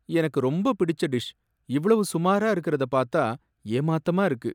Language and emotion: Tamil, sad